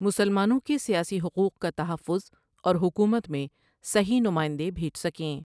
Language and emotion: Urdu, neutral